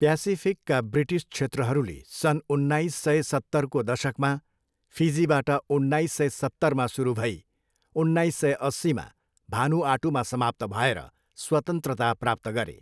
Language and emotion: Nepali, neutral